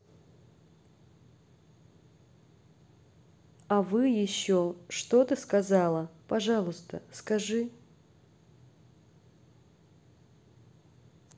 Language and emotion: Russian, neutral